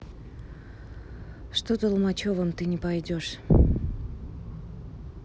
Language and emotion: Russian, neutral